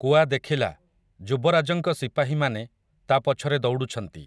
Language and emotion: Odia, neutral